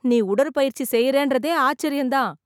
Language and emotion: Tamil, surprised